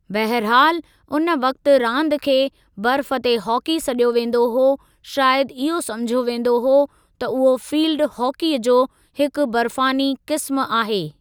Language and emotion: Sindhi, neutral